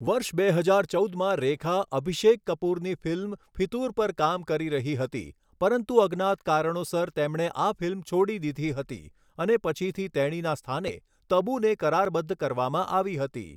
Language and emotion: Gujarati, neutral